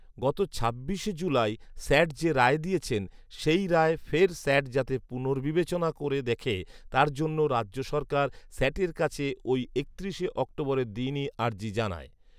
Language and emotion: Bengali, neutral